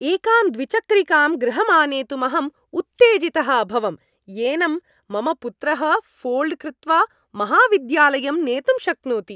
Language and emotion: Sanskrit, happy